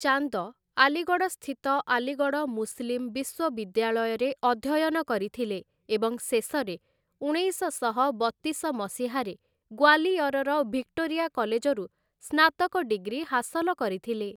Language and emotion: Odia, neutral